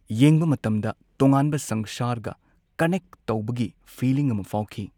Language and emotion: Manipuri, neutral